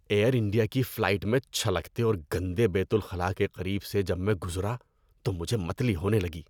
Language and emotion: Urdu, disgusted